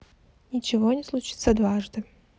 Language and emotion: Russian, sad